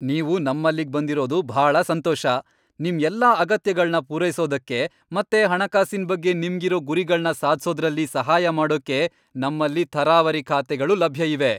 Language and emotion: Kannada, happy